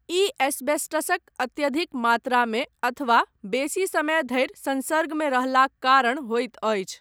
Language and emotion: Maithili, neutral